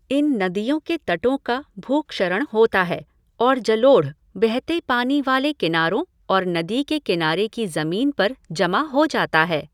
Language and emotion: Hindi, neutral